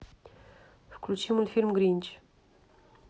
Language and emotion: Russian, neutral